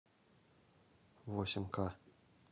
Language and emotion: Russian, neutral